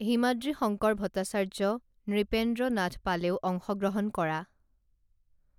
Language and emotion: Assamese, neutral